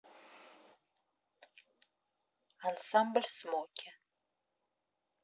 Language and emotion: Russian, neutral